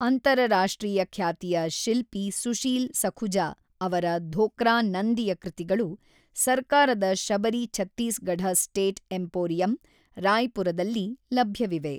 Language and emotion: Kannada, neutral